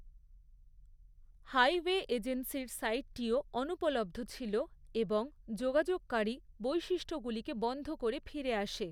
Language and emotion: Bengali, neutral